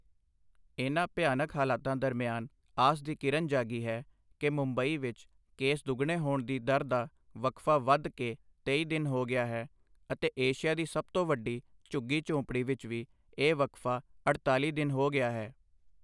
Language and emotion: Punjabi, neutral